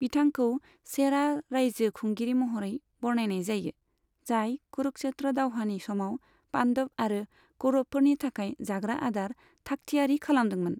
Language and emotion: Bodo, neutral